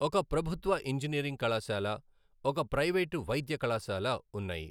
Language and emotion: Telugu, neutral